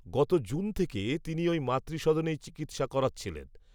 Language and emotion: Bengali, neutral